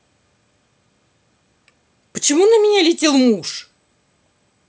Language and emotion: Russian, angry